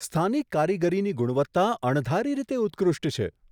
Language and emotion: Gujarati, surprised